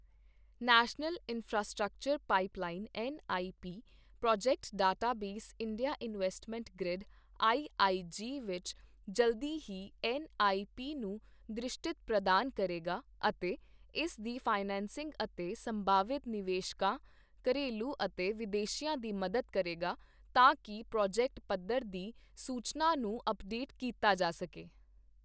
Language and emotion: Punjabi, neutral